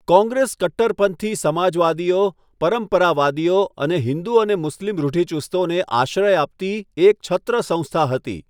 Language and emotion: Gujarati, neutral